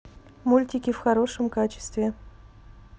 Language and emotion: Russian, neutral